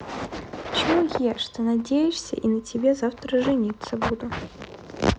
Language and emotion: Russian, neutral